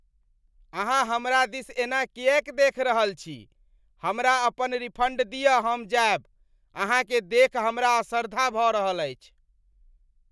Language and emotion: Maithili, disgusted